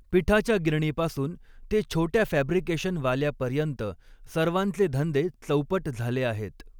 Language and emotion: Marathi, neutral